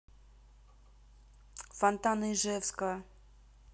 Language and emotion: Russian, neutral